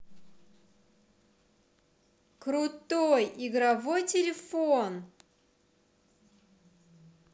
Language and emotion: Russian, positive